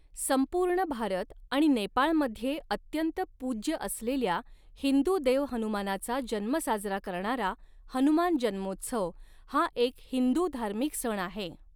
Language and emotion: Marathi, neutral